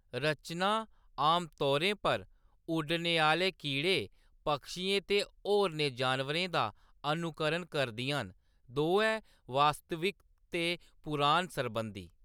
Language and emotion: Dogri, neutral